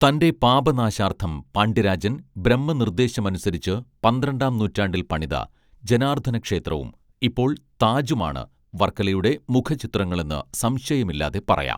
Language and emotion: Malayalam, neutral